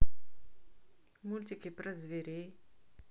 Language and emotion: Russian, neutral